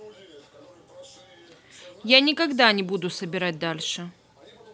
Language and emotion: Russian, neutral